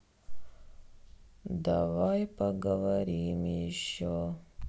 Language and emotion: Russian, sad